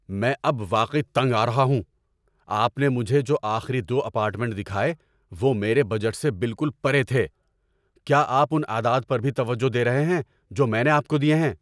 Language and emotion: Urdu, angry